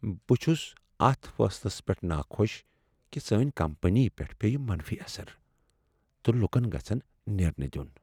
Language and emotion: Kashmiri, sad